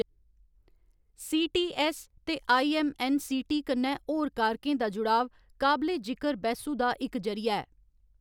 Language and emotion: Dogri, neutral